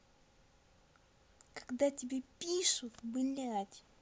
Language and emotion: Russian, angry